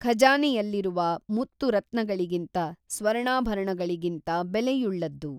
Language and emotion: Kannada, neutral